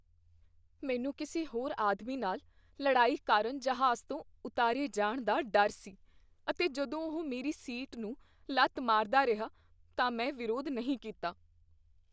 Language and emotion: Punjabi, fearful